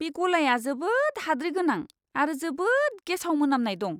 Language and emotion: Bodo, disgusted